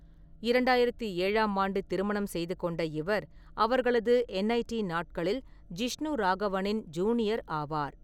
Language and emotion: Tamil, neutral